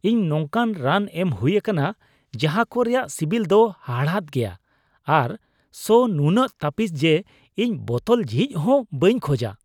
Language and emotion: Santali, disgusted